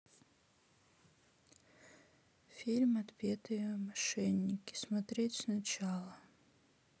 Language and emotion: Russian, sad